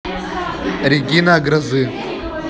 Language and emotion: Russian, neutral